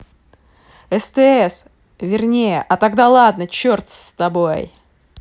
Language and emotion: Russian, angry